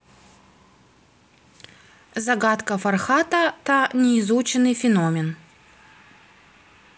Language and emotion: Russian, neutral